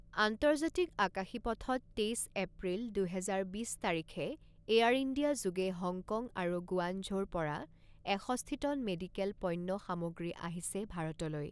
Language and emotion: Assamese, neutral